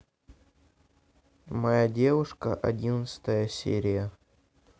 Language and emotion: Russian, neutral